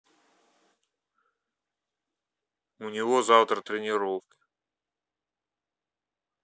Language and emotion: Russian, neutral